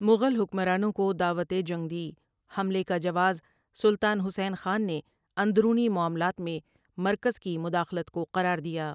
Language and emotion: Urdu, neutral